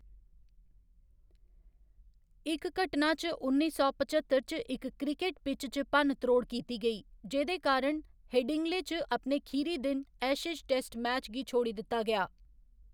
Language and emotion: Dogri, neutral